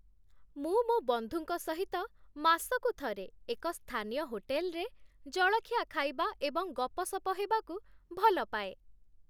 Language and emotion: Odia, happy